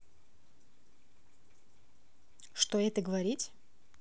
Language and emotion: Russian, neutral